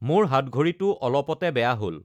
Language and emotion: Assamese, neutral